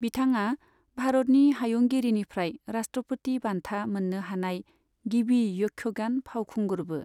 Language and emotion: Bodo, neutral